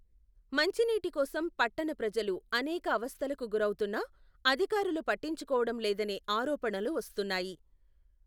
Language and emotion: Telugu, neutral